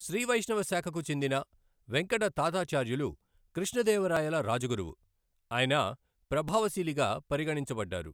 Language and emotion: Telugu, neutral